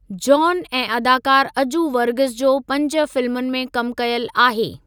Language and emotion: Sindhi, neutral